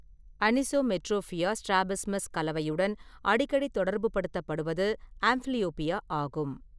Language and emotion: Tamil, neutral